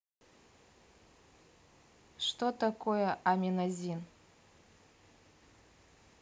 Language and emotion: Russian, neutral